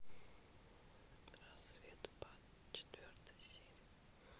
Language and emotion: Russian, neutral